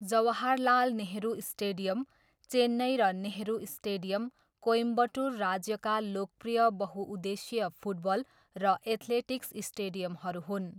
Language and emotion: Nepali, neutral